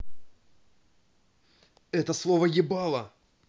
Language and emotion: Russian, angry